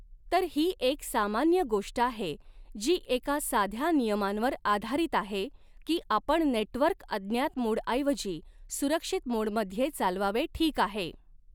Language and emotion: Marathi, neutral